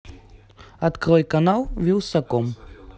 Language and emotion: Russian, neutral